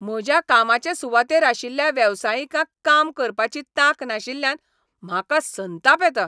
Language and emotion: Goan Konkani, angry